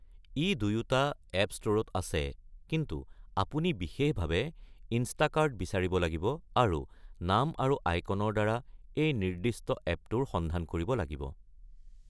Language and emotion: Assamese, neutral